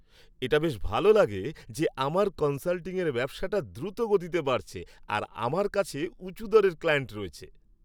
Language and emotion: Bengali, happy